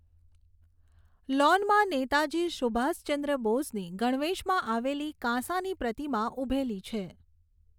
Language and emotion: Gujarati, neutral